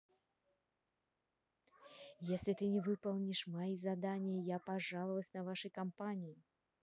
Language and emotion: Russian, neutral